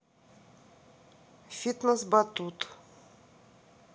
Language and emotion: Russian, neutral